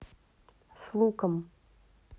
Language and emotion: Russian, neutral